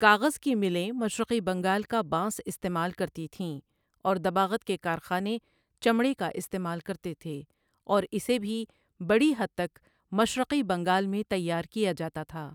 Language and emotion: Urdu, neutral